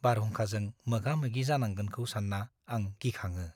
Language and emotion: Bodo, fearful